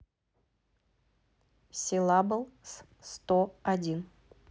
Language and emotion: Russian, neutral